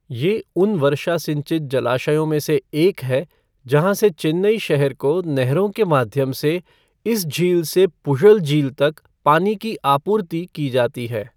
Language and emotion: Hindi, neutral